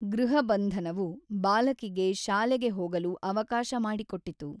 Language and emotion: Kannada, neutral